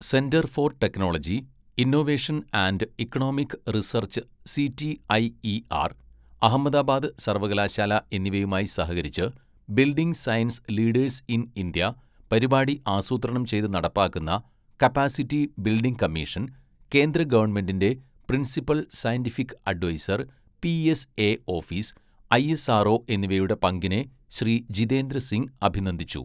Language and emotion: Malayalam, neutral